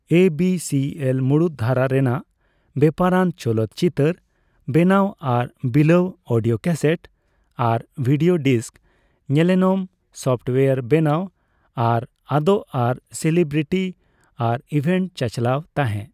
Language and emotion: Santali, neutral